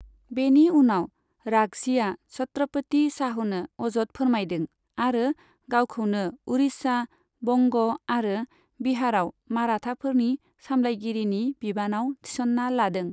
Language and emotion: Bodo, neutral